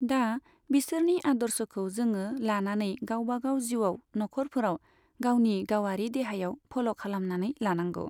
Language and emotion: Bodo, neutral